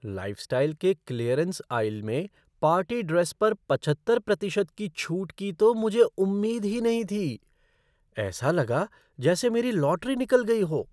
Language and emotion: Hindi, surprised